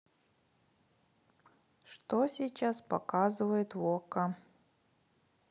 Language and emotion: Russian, neutral